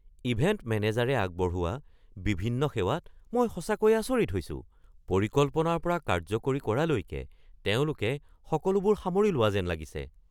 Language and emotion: Assamese, surprised